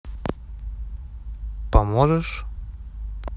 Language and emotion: Russian, neutral